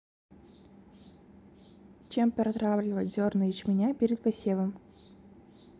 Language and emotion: Russian, neutral